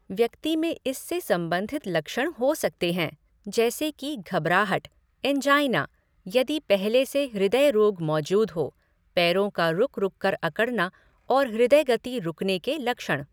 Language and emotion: Hindi, neutral